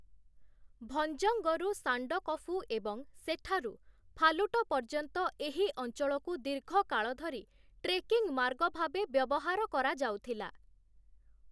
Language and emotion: Odia, neutral